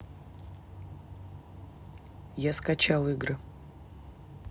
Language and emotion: Russian, neutral